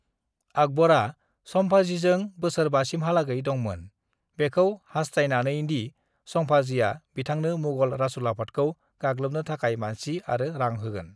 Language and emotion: Bodo, neutral